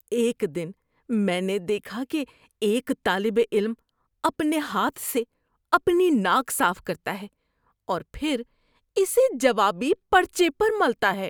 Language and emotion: Urdu, disgusted